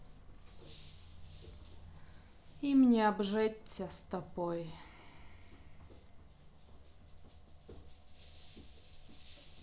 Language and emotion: Russian, sad